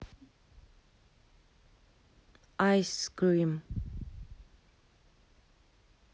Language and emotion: Russian, neutral